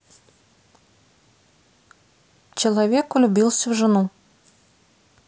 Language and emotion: Russian, neutral